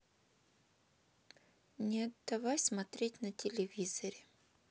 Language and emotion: Russian, sad